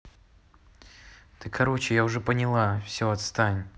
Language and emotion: Russian, angry